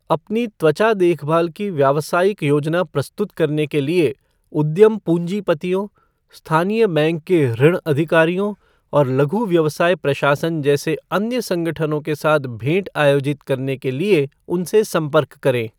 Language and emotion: Hindi, neutral